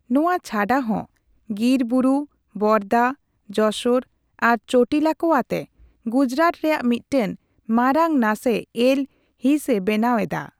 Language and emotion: Santali, neutral